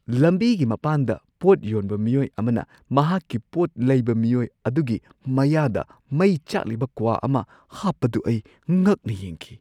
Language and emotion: Manipuri, surprised